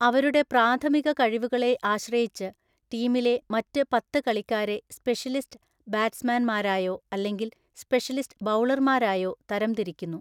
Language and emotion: Malayalam, neutral